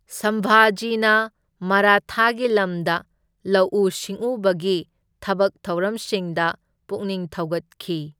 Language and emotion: Manipuri, neutral